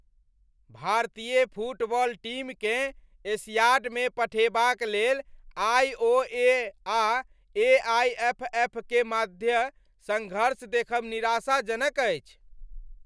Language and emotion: Maithili, angry